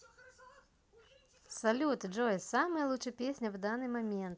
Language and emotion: Russian, positive